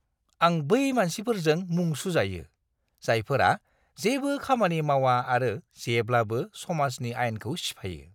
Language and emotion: Bodo, disgusted